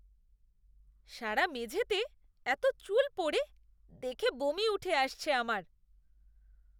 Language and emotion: Bengali, disgusted